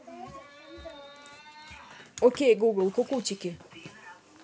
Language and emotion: Russian, neutral